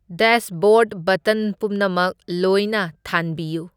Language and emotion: Manipuri, neutral